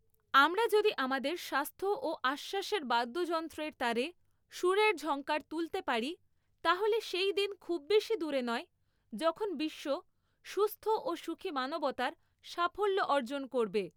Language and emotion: Bengali, neutral